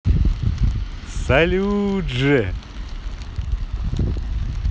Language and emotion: Russian, positive